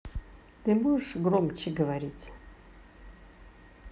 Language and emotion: Russian, angry